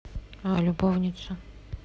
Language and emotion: Russian, neutral